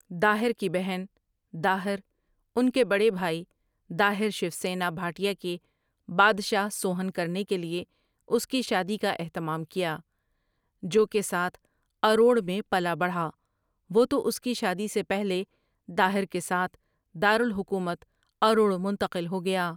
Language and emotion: Urdu, neutral